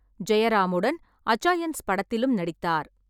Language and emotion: Tamil, neutral